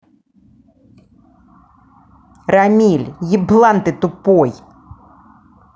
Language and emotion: Russian, angry